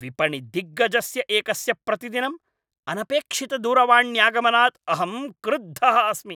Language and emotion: Sanskrit, angry